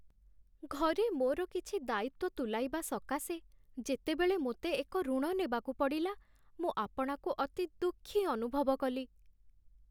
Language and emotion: Odia, sad